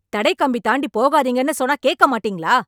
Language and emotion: Tamil, angry